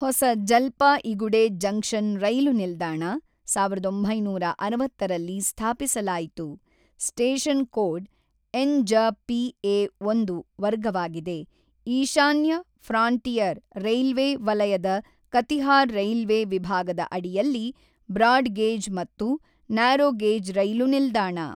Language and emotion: Kannada, neutral